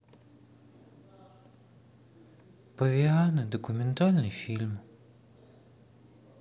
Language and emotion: Russian, sad